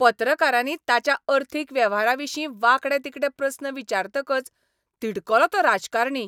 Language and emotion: Goan Konkani, angry